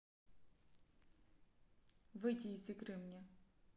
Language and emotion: Russian, neutral